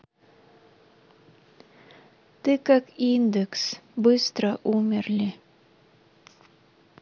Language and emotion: Russian, neutral